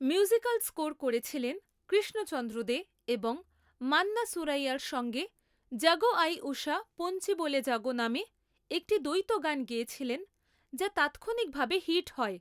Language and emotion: Bengali, neutral